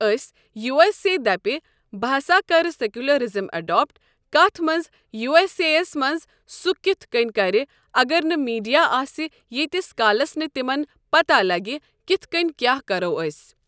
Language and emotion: Kashmiri, neutral